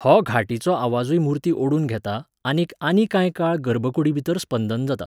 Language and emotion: Goan Konkani, neutral